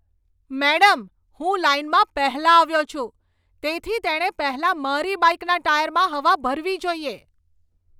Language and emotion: Gujarati, angry